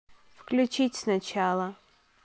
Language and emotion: Russian, neutral